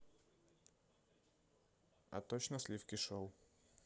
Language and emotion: Russian, neutral